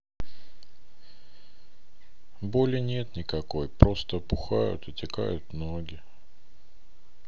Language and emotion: Russian, sad